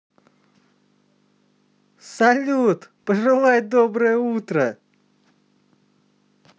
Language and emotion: Russian, positive